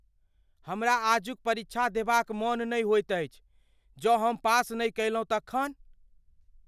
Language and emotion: Maithili, fearful